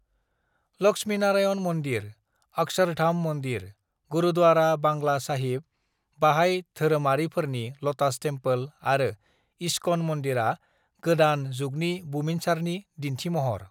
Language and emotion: Bodo, neutral